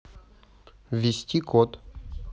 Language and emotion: Russian, neutral